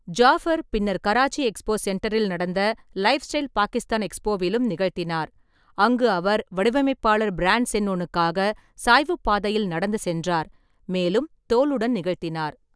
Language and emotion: Tamil, neutral